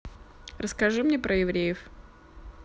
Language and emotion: Russian, neutral